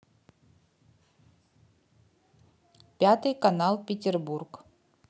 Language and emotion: Russian, neutral